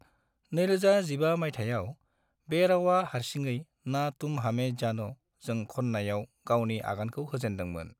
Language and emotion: Bodo, neutral